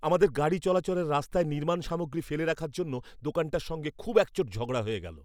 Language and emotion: Bengali, angry